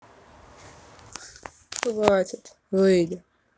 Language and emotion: Russian, sad